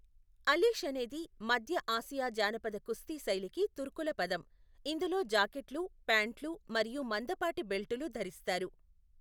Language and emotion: Telugu, neutral